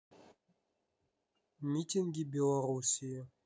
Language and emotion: Russian, neutral